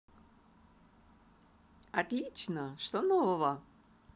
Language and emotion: Russian, positive